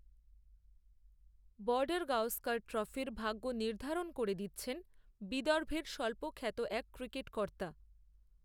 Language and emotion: Bengali, neutral